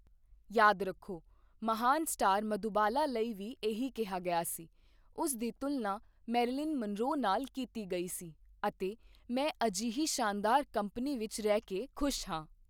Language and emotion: Punjabi, neutral